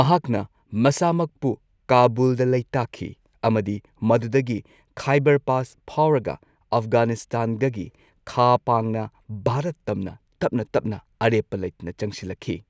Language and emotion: Manipuri, neutral